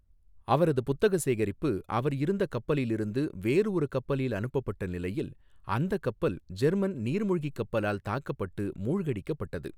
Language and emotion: Tamil, neutral